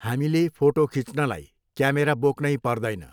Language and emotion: Nepali, neutral